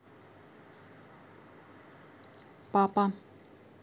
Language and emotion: Russian, neutral